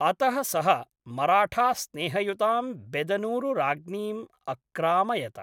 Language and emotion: Sanskrit, neutral